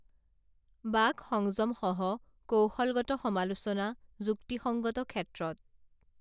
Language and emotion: Assamese, neutral